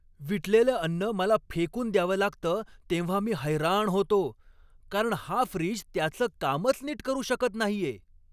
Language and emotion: Marathi, angry